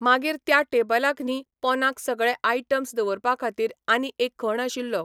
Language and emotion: Goan Konkani, neutral